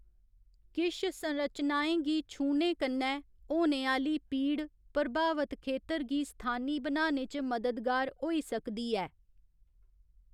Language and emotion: Dogri, neutral